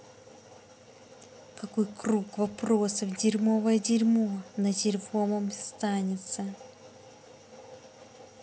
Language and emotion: Russian, angry